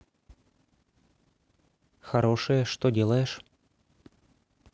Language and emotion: Russian, neutral